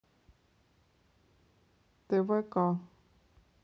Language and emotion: Russian, neutral